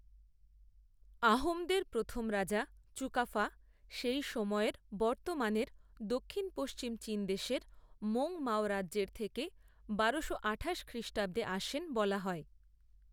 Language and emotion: Bengali, neutral